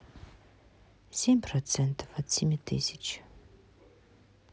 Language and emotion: Russian, sad